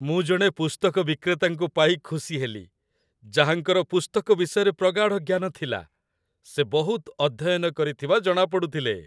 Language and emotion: Odia, happy